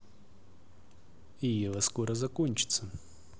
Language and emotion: Russian, neutral